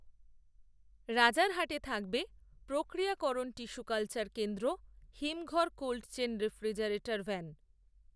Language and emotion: Bengali, neutral